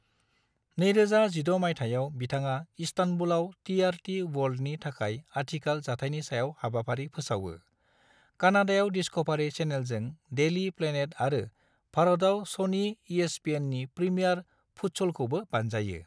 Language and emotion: Bodo, neutral